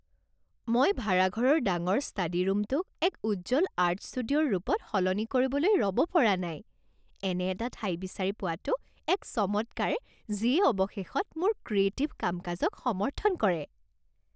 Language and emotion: Assamese, happy